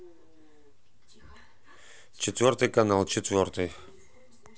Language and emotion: Russian, neutral